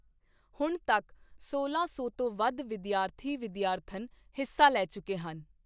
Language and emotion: Punjabi, neutral